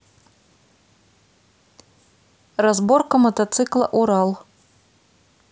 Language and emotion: Russian, neutral